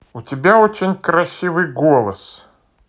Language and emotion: Russian, positive